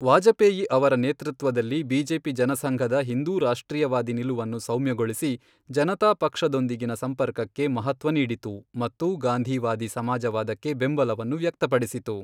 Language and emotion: Kannada, neutral